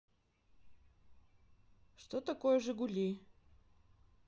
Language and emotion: Russian, neutral